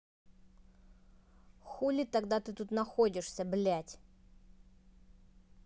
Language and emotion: Russian, angry